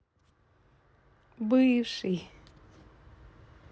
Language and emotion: Russian, positive